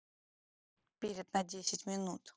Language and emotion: Russian, neutral